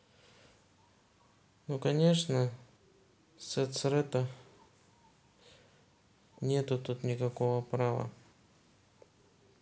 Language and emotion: Russian, neutral